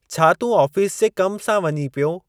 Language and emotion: Sindhi, neutral